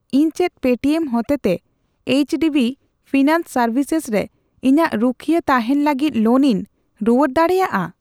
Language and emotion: Santali, neutral